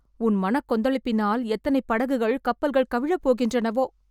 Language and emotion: Tamil, fearful